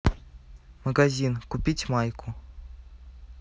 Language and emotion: Russian, neutral